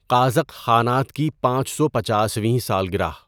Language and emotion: Urdu, neutral